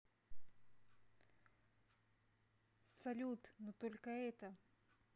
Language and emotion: Russian, neutral